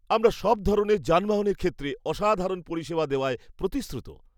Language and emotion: Bengali, happy